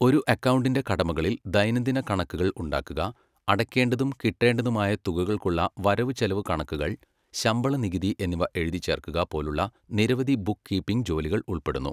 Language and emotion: Malayalam, neutral